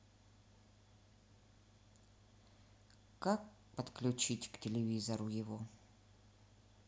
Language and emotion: Russian, sad